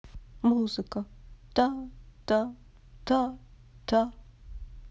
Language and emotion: Russian, sad